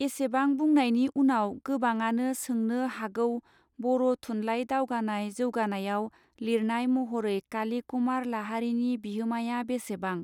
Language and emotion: Bodo, neutral